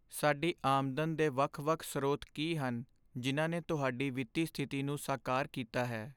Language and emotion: Punjabi, sad